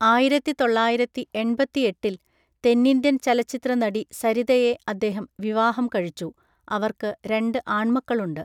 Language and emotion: Malayalam, neutral